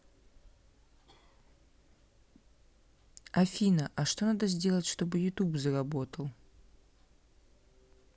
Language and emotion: Russian, neutral